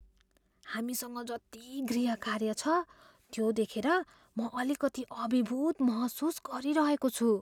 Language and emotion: Nepali, fearful